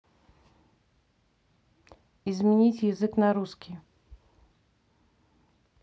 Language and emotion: Russian, neutral